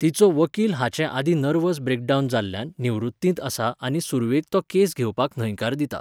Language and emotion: Goan Konkani, neutral